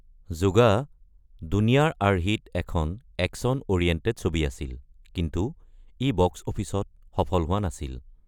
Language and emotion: Assamese, neutral